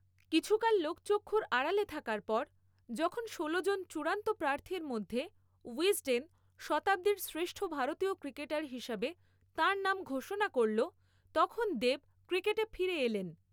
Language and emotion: Bengali, neutral